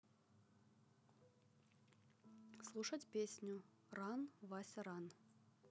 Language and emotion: Russian, neutral